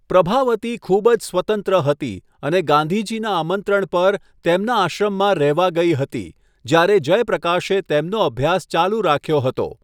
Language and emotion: Gujarati, neutral